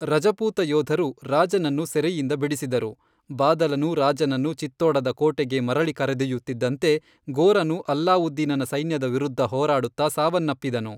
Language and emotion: Kannada, neutral